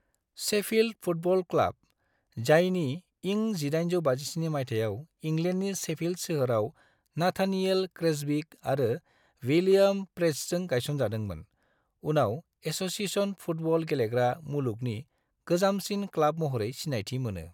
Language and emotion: Bodo, neutral